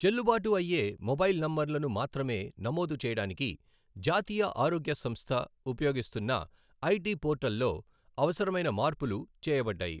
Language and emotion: Telugu, neutral